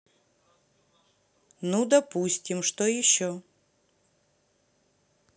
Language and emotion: Russian, neutral